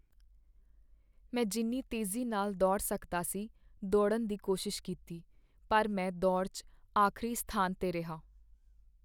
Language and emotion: Punjabi, sad